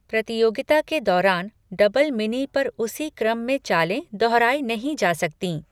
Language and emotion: Hindi, neutral